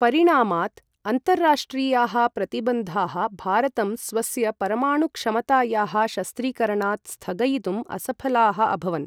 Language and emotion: Sanskrit, neutral